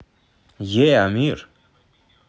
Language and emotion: Russian, positive